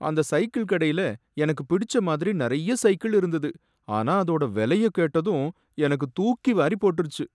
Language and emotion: Tamil, sad